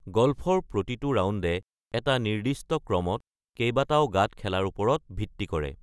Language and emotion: Assamese, neutral